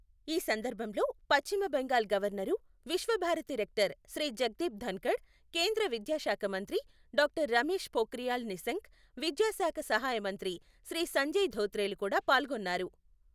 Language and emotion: Telugu, neutral